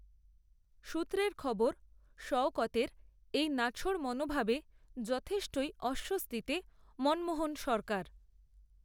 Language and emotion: Bengali, neutral